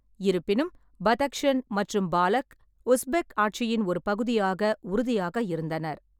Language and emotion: Tamil, neutral